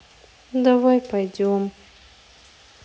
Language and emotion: Russian, sad